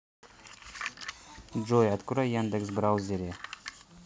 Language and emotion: Russian, neutral